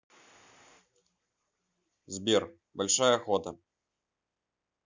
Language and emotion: Russian, neutral